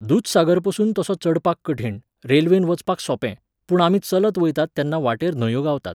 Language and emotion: Goan Konkani, neutral